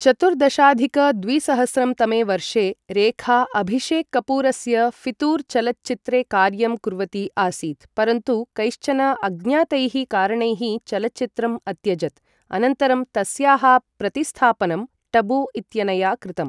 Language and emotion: Sanskrit, neutral